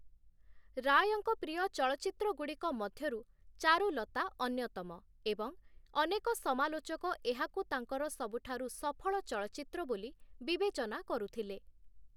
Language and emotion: Odia, neutral